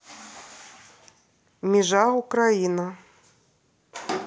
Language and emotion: Russian, neutral